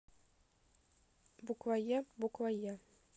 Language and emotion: Russian, neutral